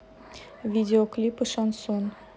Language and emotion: Russian, neutral